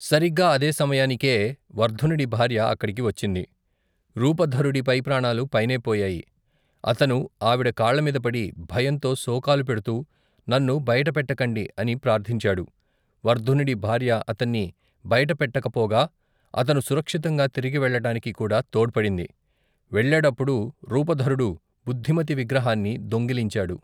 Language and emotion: Telugu, neutral